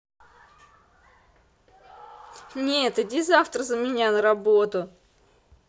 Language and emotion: Russian, angry